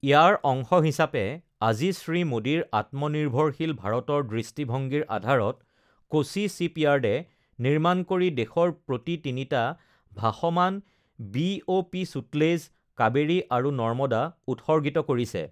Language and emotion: Assamese, neutral